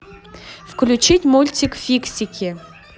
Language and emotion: Russian, neutral